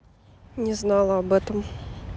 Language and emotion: Russian, neutral